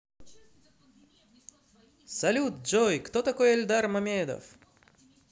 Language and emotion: Russian, positive